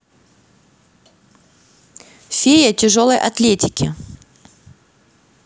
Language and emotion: Russian, neutral